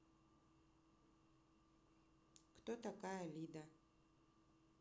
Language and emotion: Russian, neutral